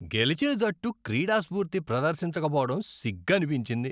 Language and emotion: Telugu, disgusted